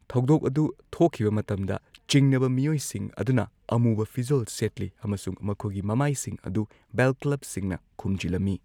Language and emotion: Manipuri, neutral